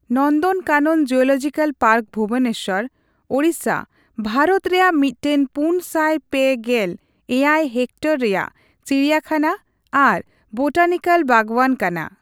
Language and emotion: Santali, neutral